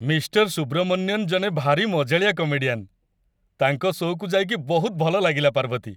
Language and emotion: Odia, happy